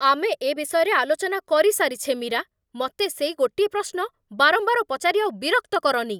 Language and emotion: Odia, angry